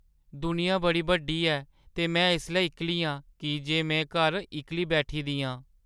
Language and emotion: Dogri, sad